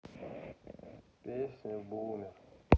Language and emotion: Russian, sad